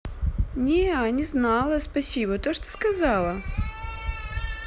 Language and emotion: Russian, positive